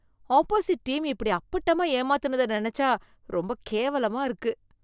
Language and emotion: Tamil, disgusted